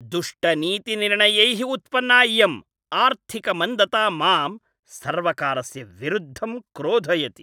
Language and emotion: Sanskrit, angry